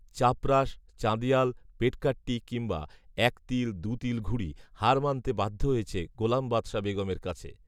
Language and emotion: Bengali, neutral